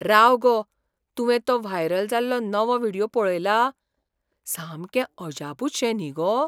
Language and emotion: Goan Konkani, surprised